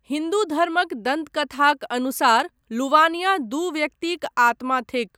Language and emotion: Maithili, neutral